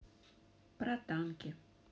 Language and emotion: Russian, neutral